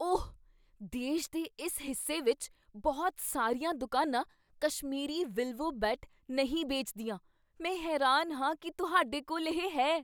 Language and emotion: Punjabi, surprised